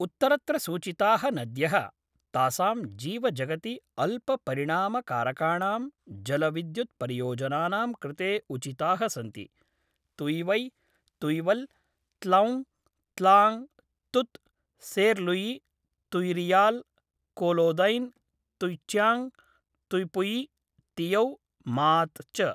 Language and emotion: Sanskrit, neutral